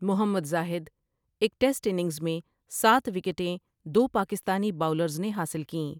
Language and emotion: Urdu, neutral